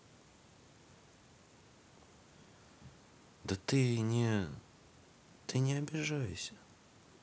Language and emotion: Russian, sad